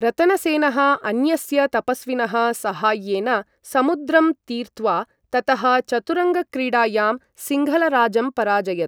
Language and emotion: Sanskrit, neutral